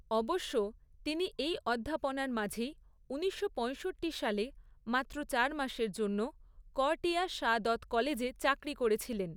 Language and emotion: Bengali, neutral